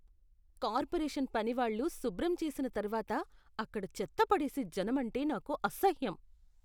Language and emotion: Telugu, disgusted